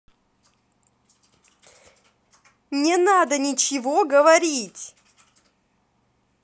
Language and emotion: Russian, angry